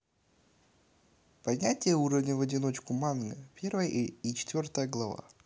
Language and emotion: Russian, neutral